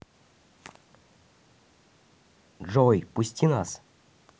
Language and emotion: Russian, neutral